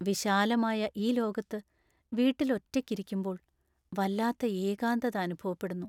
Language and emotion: Malayalam, sad